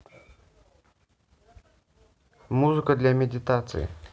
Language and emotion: Russian, neutral